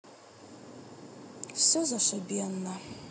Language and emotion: Russian, sad